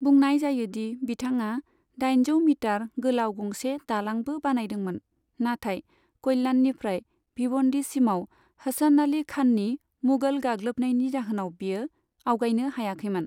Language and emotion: Bodo, neutral